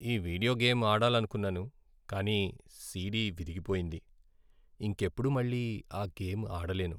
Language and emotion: Telugu, sad